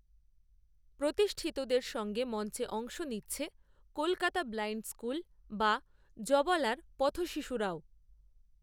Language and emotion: Bengali, neutral